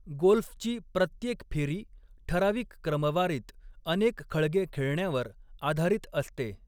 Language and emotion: Marathi, neutral